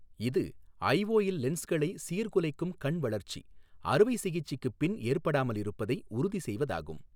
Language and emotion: Tamil, neutral